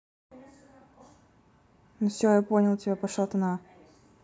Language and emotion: Russian, neutral